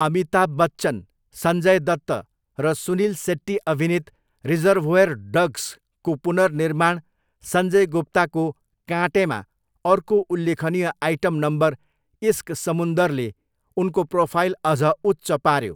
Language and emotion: Nepali, neutral